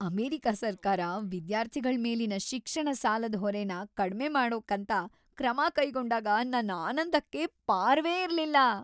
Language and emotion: Kannada, happy